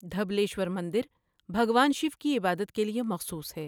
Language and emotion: Urdu, neutral